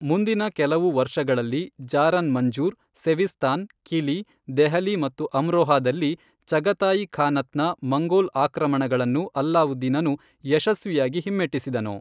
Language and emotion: Kannada, neutral